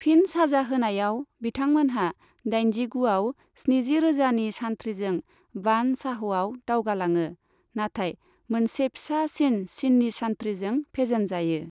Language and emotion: Bodo, neutral